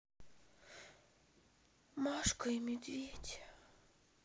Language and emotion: Russian, sad